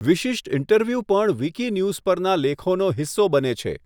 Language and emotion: Gujarati, neutral